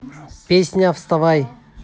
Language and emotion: Russian, positive